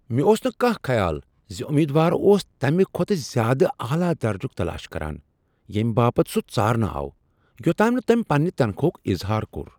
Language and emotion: Kashmiri, surprised